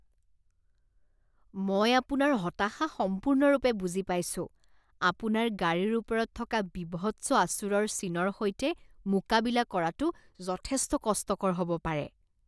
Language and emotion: Assamese, disgusted